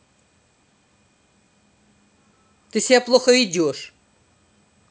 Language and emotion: Russian, angry